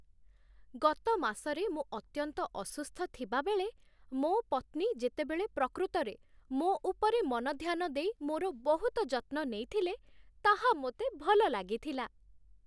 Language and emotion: Odia, happy